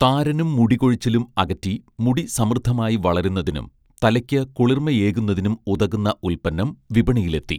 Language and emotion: Malayalam, neutral